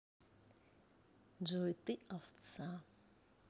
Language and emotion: Russian, neutral